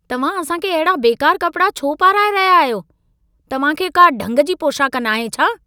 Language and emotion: Sindhi, angry